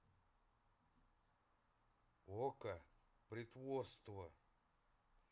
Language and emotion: Russian, neutral